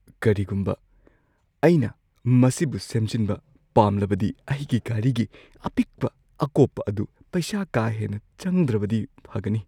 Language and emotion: Manipuri, fearful